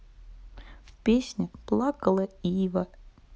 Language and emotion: Russian, sad